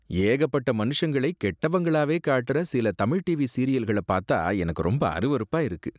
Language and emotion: Tamil, disgusted